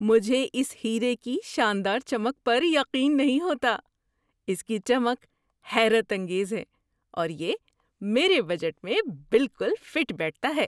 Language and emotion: Urdu, surprised